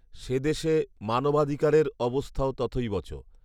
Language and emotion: Bengali, neutral